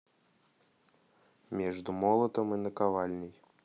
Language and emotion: Russian, neutral